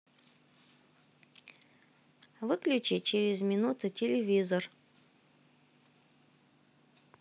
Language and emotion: Russian, neutral